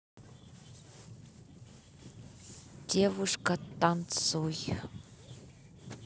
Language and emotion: Russian, neutral